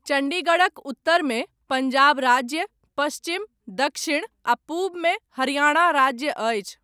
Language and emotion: Maithili, neutral